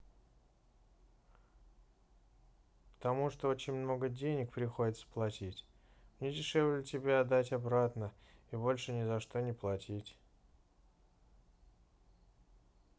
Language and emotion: Russian, neutral